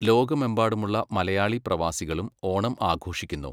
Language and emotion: Malayalam, neutral